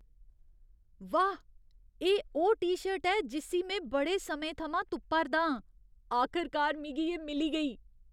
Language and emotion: Dogri, surprised